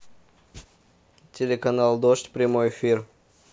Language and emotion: Russian, neutral